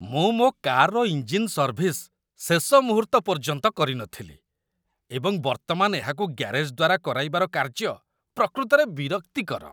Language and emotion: Odia, disgusted